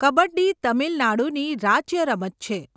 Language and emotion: Gujarati, neutral